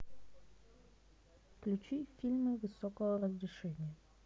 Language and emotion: Russian, neutral